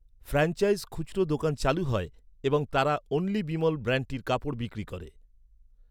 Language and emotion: Bengali, neutral